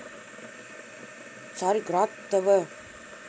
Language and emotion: Russian, neutral